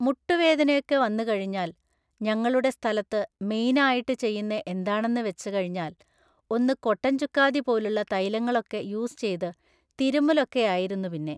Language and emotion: Malayalam, neutral